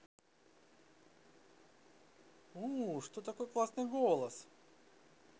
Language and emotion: Russian, positive